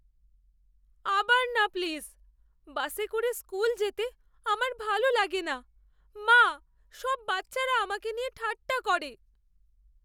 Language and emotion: Bengali, fearful